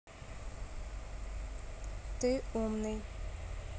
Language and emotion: Russian, neutral